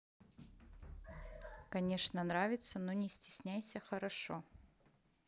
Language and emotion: Russian, neutral